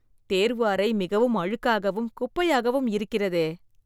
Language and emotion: Tamil, disgusted